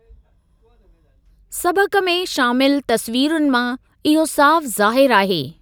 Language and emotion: Sindhi, neutral